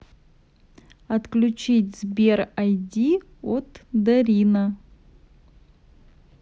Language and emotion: Russian, neutral